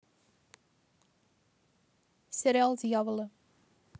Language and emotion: Russian, neutral